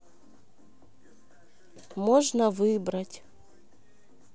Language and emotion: Russian, neutral